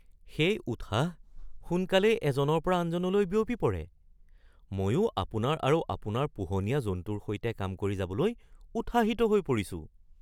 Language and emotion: Assamese, surprised